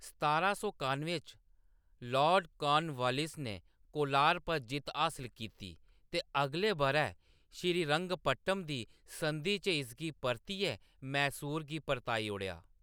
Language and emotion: Dogri, neutral